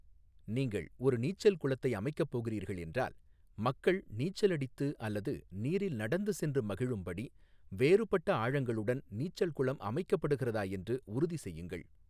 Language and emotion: Tamil, neutral